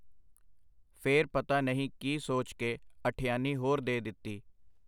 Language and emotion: Punjabi, neutral